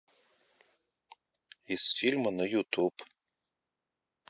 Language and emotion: Russian, neutral